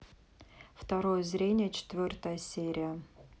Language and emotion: Russian, neutral